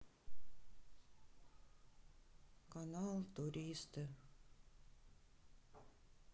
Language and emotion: Russian, sad